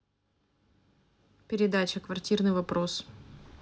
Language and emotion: Russian, neutral